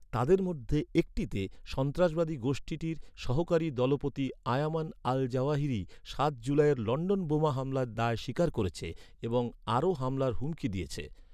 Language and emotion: Bengali, neutral